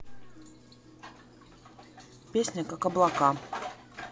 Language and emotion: Russian, neutral